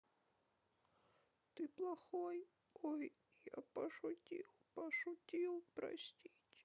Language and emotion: Russian, sad